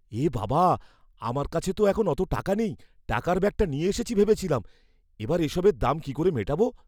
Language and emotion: Bengali, fearful